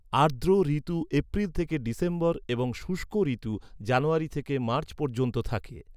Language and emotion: Bengali, neutral